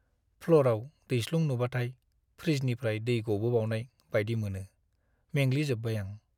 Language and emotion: Bodo, sad